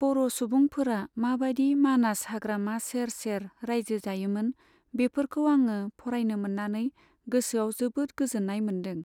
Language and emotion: Bodo, neutral